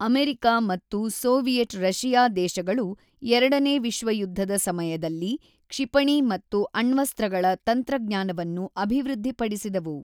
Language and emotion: Kannada, neutral